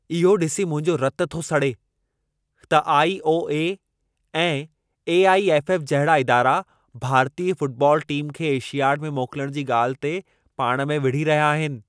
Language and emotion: Sindhi, angry